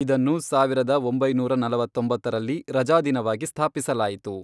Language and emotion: Kannada, neutral